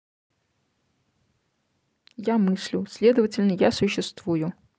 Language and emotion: Russian, neutral